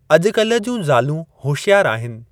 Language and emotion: Sindhi, neutral